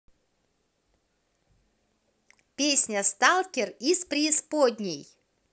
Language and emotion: Russian, positive